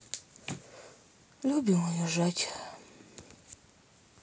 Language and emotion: Russian, sad